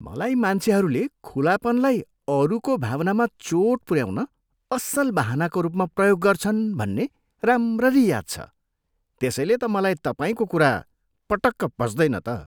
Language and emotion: Nepali, disgusted